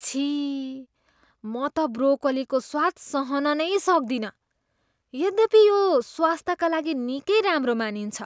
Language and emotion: Nepali, disgusted